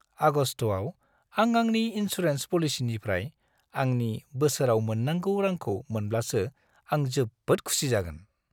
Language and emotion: Bodo, happy